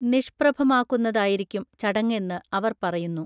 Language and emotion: Malayalam, neutral